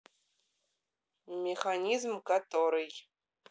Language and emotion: Russian, neutral